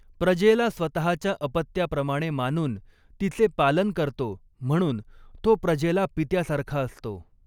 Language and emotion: Marathi, neutral